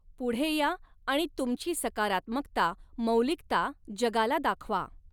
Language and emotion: Marathi, neutral